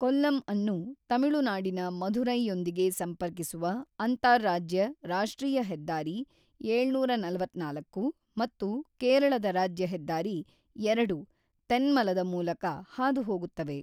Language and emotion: Kannada, neutral